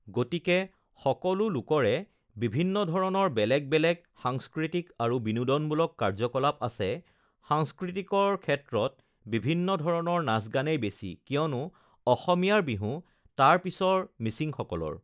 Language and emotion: Assamese, neutral